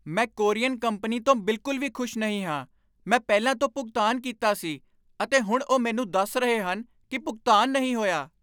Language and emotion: Punjabi, angry